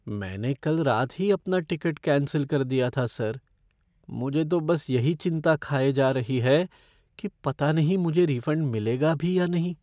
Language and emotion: Hindi, fearful